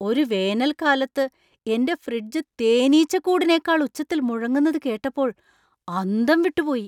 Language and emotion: Malayalam, surprised